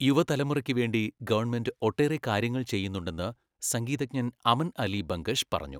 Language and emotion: Malayalam, neutral